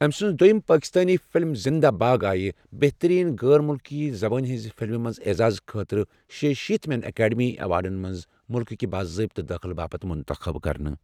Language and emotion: Kashmiri, neutral